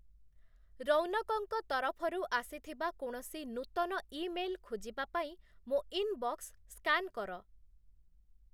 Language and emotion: Odia, neutral